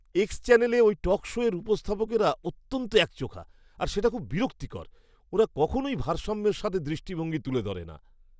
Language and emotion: Bengali, disgusted